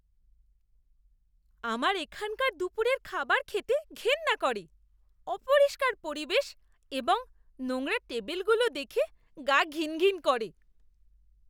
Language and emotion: Bengali, disgusted